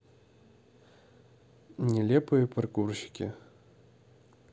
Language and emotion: Russian, neutral